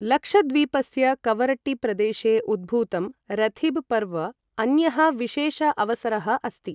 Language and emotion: Sanskrit, neutral